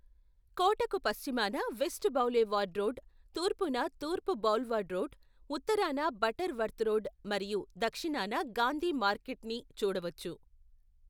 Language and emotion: Telugu, neutral